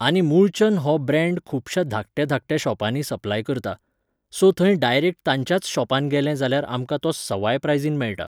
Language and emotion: Goan Konkani, neutral